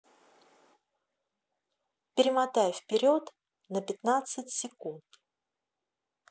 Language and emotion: Russian, neutral